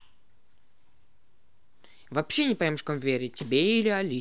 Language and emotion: Russian, neutral